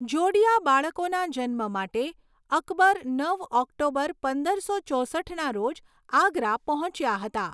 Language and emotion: Gujarati, neutral